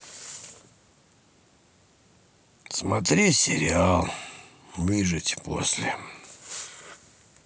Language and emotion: Russian, sad